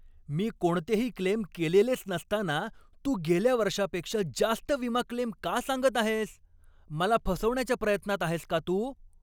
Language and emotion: Marathi, angry